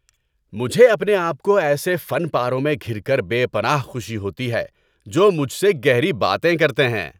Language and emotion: Urdu, happy